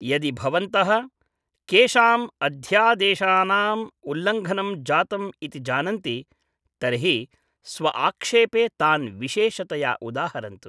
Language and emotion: Sanskrit, neutral